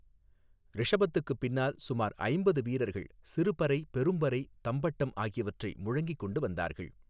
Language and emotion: Tamil, neutral